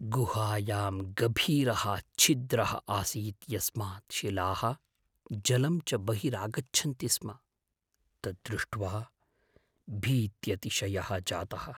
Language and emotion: Sanskrit, fearful